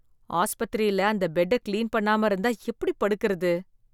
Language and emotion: Tamil, disgusted